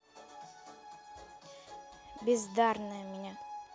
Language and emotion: Russian, angry